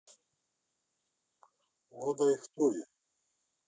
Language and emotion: Russian, neutral